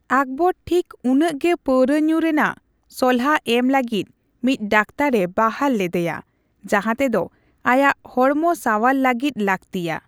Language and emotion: Santali, neutral